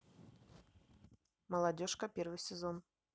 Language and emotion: Russian, neutral